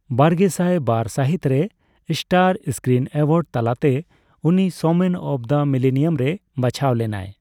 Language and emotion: Santali, neutral